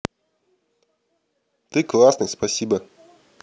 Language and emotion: Russian, positive